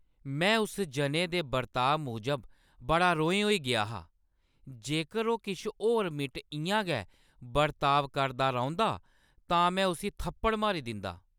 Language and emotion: Dogri, angry